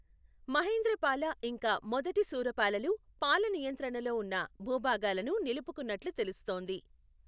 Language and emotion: Telugu, neutral